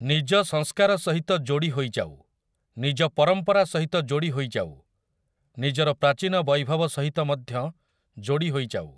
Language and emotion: Odia, neutral